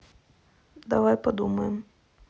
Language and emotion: Russian, neutral